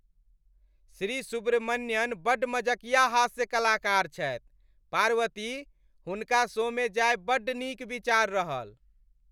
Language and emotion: Maithili, happy